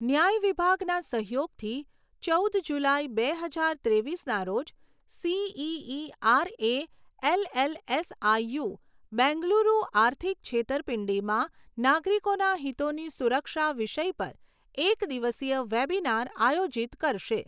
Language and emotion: Gujarati, neutral